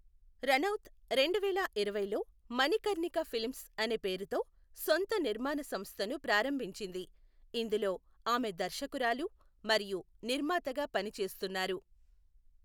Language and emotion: Telugu, neutral